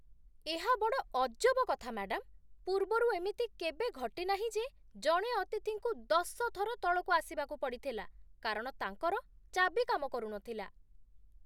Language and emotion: Odia, surprised